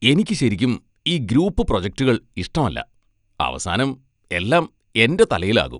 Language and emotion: Malayalam, disgusted